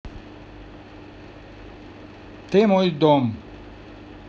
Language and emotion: Russian, neutral